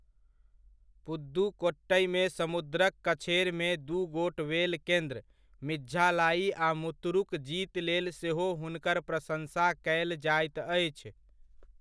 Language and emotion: Maithili, neutral